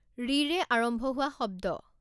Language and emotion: Assamese, neutral